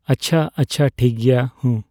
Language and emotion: Santali, neutral